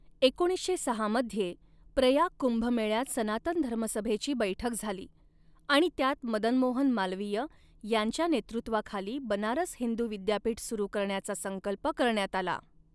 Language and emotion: Marathi, neutral